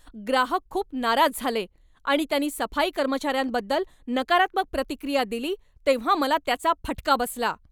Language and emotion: Marathi, angry